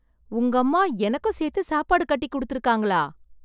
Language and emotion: Tamil, surprised